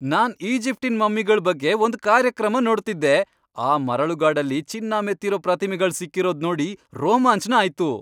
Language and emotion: Kannada, happy